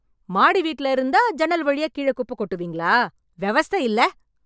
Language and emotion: Tamil, angry